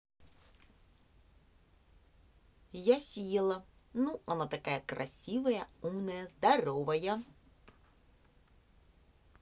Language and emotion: Russian, positive